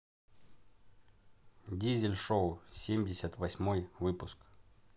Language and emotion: Russian, neutral